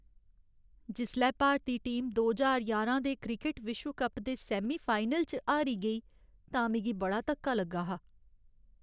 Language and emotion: Dogri, sad